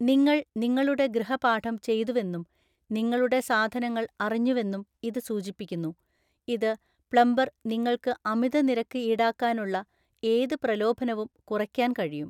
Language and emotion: Malayalam, neutral